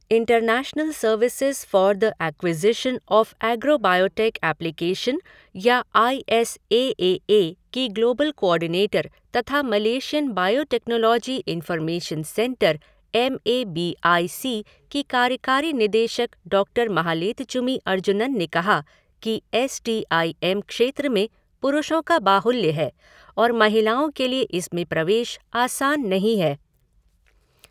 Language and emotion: Hindi, neutral